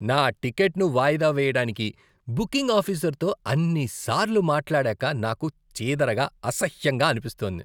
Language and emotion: Telugu, disgusted